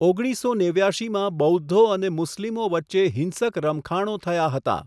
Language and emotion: Gujarati, neutral